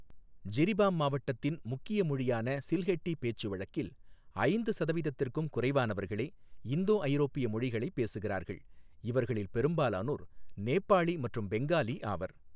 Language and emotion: Tamil, neutral